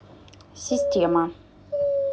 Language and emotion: Russian, neutral